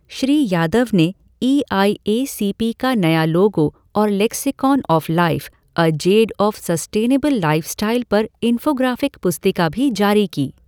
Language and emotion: Hindi, neutral